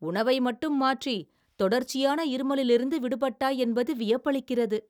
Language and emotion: Tamil, surprised